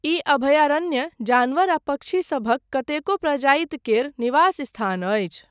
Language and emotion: Maithili, neutral